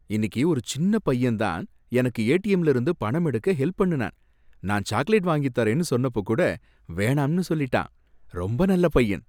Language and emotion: Tamil, happy